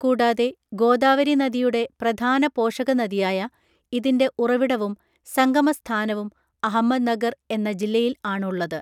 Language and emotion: Malayalam, neutral